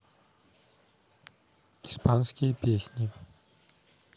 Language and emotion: Russian, neutral